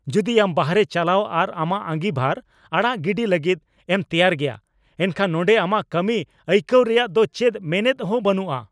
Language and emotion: Santali, angry